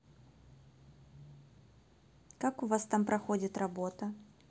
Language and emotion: Russian, neutral